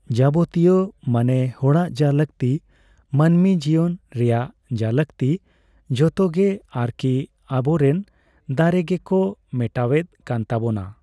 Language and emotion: Santali, neutral